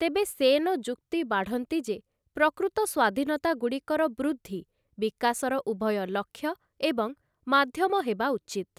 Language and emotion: Odia, neutral